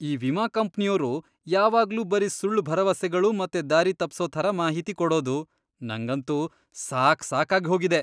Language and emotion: Kannada, disgusted